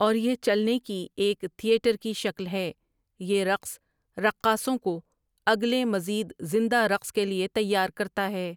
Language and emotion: Urdu, neutral